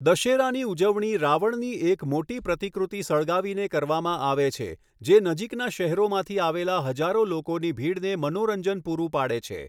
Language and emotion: Gujarati, neutral